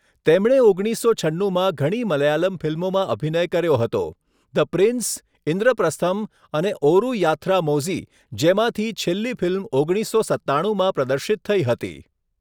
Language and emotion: Gujarati, neutral